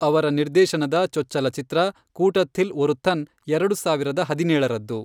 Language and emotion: Kannada, neutral